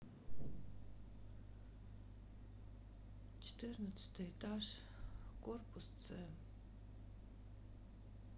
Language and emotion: Russian, sad